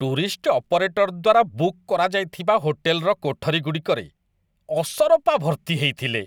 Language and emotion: Odia, disgusted